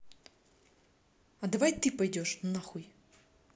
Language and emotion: Russian, angry